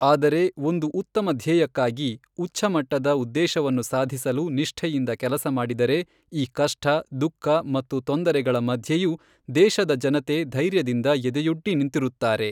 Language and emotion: Kannada, neutral